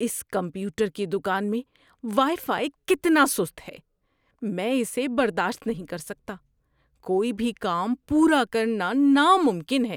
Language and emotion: Urdu, disgusted